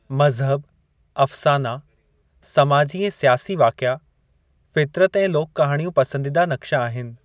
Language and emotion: Sindhi, neutral